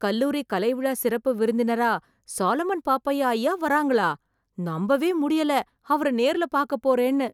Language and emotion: Tamil, surprised